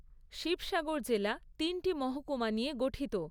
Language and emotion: Bengali, neutral